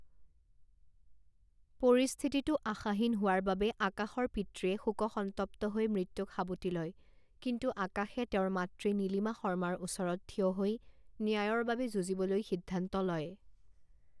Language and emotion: Assamese, neutral